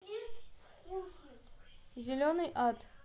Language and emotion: Russian, neutral